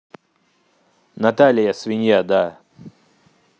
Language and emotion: Russian, neutral